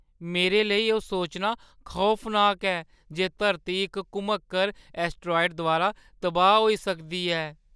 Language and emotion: Dogri, fearful